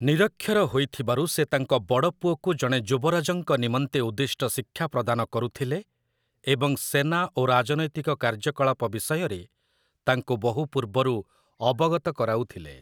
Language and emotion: Odia, neutral